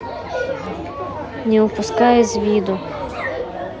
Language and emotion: Russian, neutral